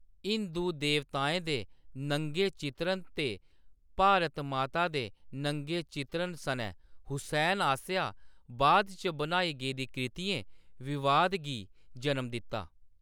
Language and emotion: Dogri, neutral